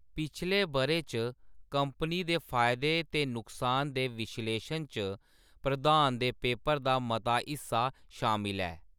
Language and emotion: Dogri, neutral